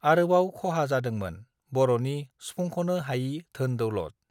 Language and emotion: Bodo, neutral